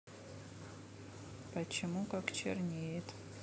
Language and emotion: Russian, neutral